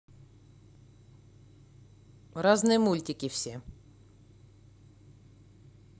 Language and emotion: Russian, neutral